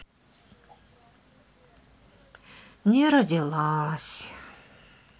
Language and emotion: Russian, sad